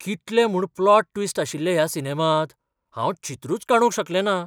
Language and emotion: Goan Konkani, surprised